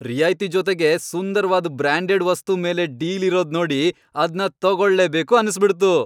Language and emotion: Kannada, happy